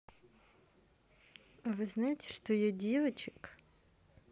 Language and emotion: Russian, neutral